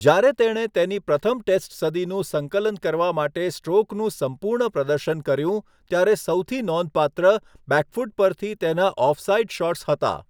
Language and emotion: Gujarati, neutral